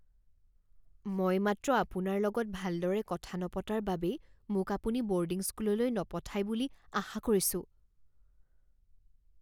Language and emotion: Assamese, fearful